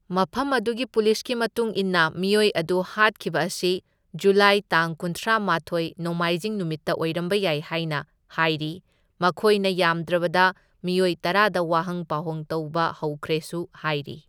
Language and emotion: Manipuri, neutral